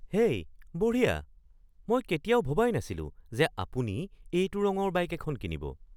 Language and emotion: Assamese, surprised